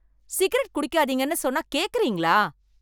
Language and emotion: Tamil, angry